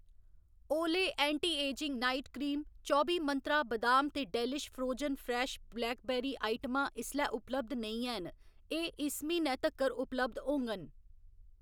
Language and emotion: Dogri, neutral